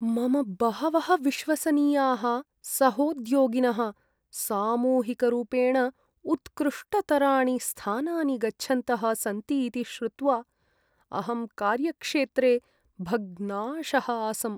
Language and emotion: Sanskrit, sad